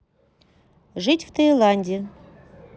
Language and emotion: Russian, neutral